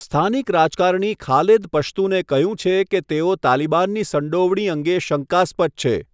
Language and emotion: Gujarati, neutral